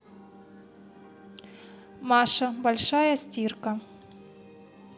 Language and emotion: Russian, neutral